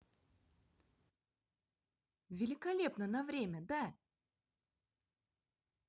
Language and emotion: Russian, positive